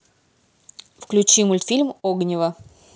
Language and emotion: Russian, neutral